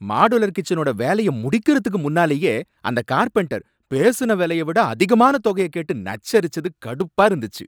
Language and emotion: Tamil, angry